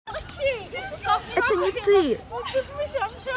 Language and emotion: Russian, positive